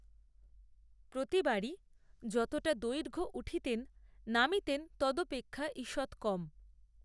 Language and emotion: Bengali, neutral